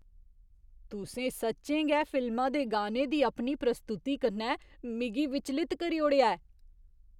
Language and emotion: Dogri, surprised